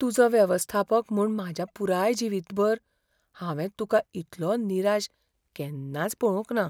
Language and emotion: Goan Konkani, fearful